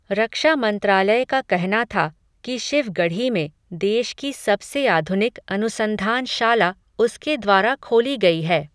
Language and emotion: Hindi, neutral